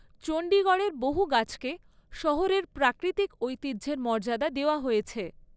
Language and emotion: Bengali, neutral